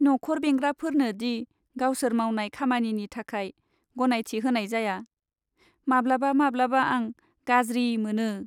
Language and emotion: Bodo, sad